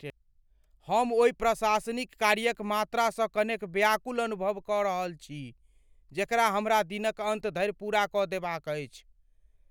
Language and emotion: Maithili, fearful